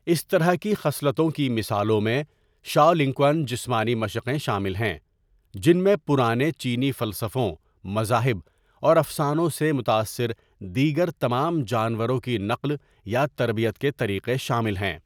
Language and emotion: Urdu, neutral